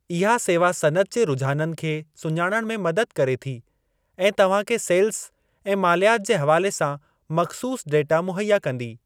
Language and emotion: Sindhi, neutral